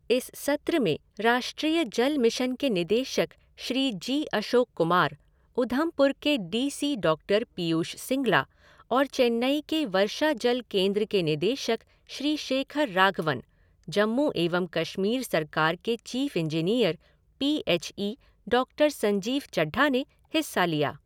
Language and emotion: Hindi, neutral